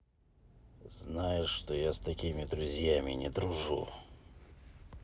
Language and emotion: Russian, angry